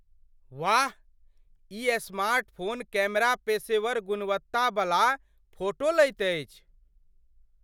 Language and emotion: Maithili, surprised